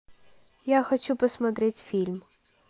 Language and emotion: Russian, neutral